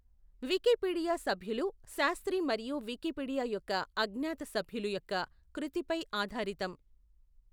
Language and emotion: Telugu, neutral